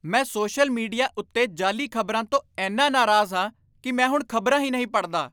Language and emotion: Punjabi, angry